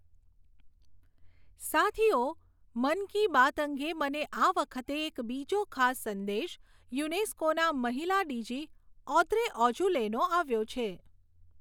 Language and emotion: Gujarati, neutral